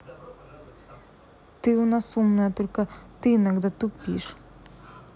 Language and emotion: Russian, neutral